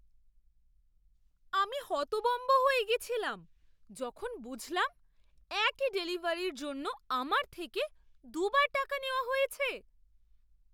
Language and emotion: Bengali, surprised